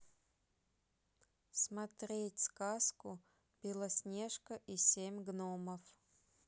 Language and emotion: Russian, neutral